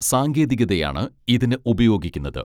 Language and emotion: Malayalam, neutral